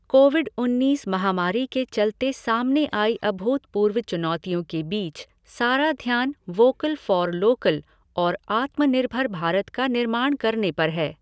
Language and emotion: Hindi, neutral